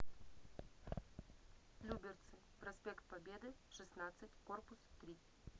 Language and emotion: Russian, neutral